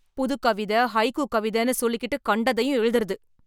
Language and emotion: Tamil, angry